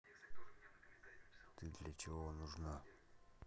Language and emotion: Russian, neutral